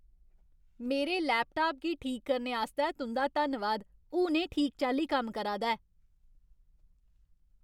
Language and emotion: Dogri, happy